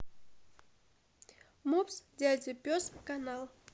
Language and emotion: Russian, neutral